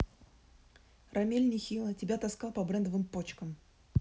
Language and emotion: Russian, neutral